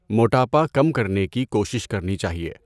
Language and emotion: Urdu, neutral